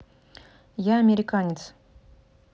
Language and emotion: Russian, neutral